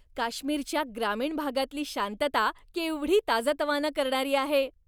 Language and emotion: Marathi, happy